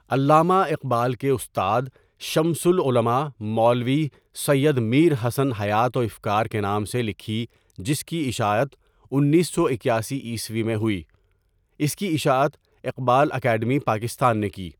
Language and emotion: Urdu, neutral